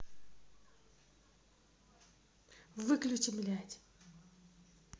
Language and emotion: Russian, angry